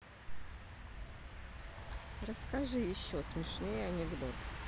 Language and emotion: Russian, neutral